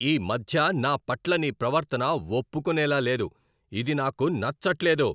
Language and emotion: Telugu, angry